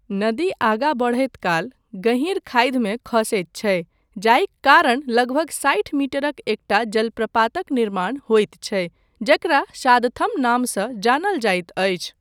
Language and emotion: Maithili, neutral